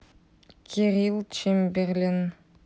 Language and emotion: Russian, neutral